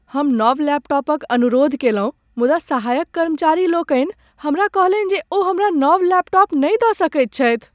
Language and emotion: Maithili, sad